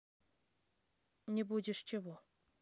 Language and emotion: Russian, neutral